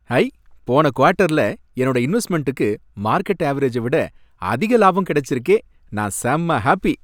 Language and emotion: Tamil, happy